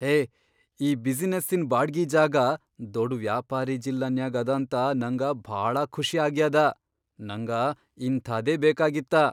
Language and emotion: Kannada, surprised